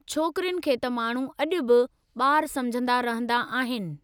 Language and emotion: Sindhi, neutral